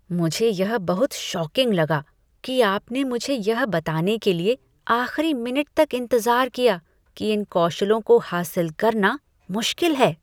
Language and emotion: Hindi, disgusted